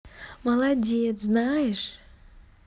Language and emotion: Russian, positive